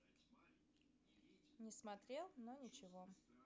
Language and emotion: Russian, neutral